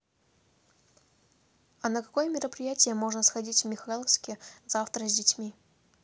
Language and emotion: Russian, neutral